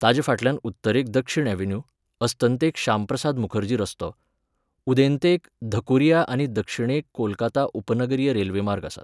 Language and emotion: Goan Konkani, neutral